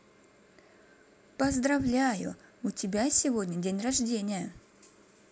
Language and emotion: Russian, positive